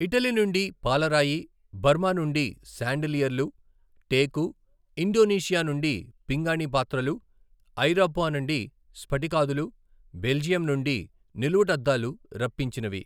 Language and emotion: Telugu, neutral